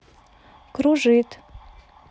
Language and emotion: Russian, neutral